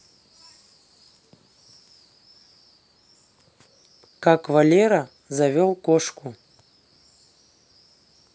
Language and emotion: Russian, neutral